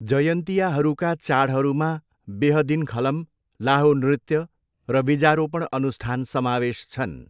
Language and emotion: Nepali, neutral